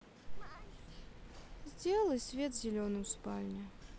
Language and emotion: Russian, sad